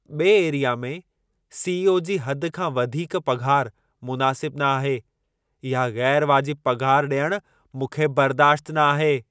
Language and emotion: Sindhi, angry